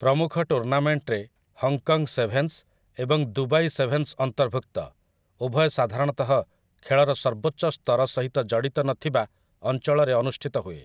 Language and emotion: Odia, neutral